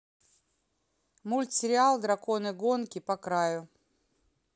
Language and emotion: Russian, neutral